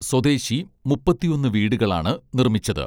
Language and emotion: Malayalam, neutral